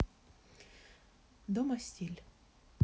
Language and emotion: Russian, neutral